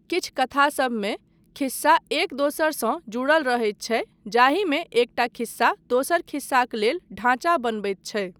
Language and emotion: Maithili, neutral